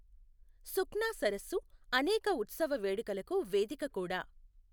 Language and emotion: Telugu, neutral